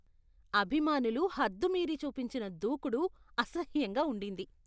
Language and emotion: Telugu, disgusted